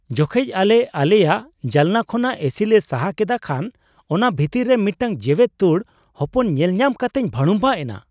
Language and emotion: Santali, surprised